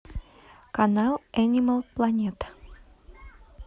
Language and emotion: Russian, neutral